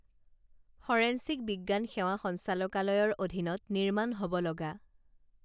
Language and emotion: Assamese, neutral